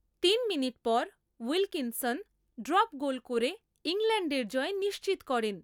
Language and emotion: Bengali, neutral